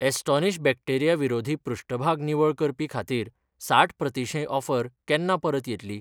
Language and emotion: Goan Konkani, neutral